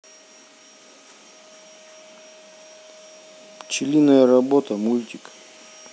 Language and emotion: Russian, neutral